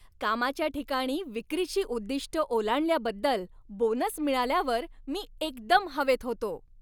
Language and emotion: Marathi, happy